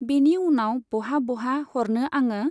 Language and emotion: Bodo, neutral